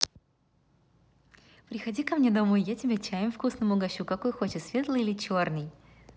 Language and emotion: Russian, positive